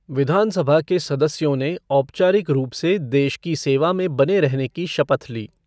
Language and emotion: Hindi, neutral